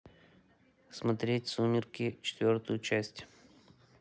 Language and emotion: Russian, neutral